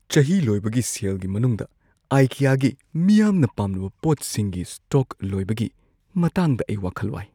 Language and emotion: Manipuri, fearful